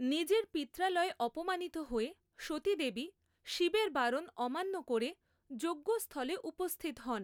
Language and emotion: Bengali, neutral